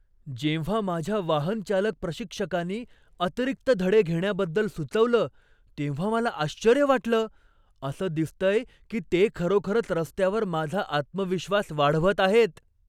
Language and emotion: Marathi, surprised